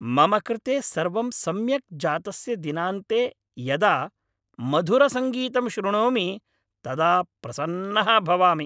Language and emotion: Sanskrit, happy